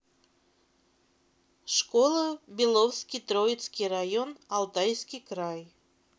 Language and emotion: Russian, neutral